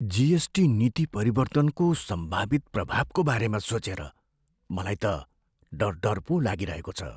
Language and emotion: Nepali, fearful